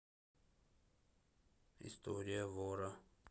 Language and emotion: Russian, neutral